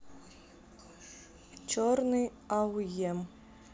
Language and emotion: Russian, neutral